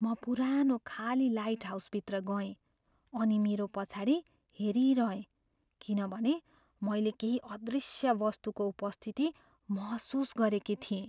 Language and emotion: Nepali, fearful